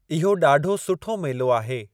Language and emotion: Sindhi, neutral